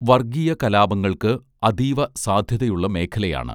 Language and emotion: Malayalam, neutral